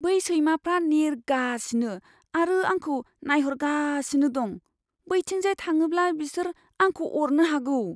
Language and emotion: Bodo, fearful